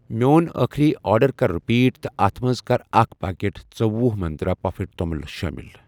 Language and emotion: Kashmiri, neutral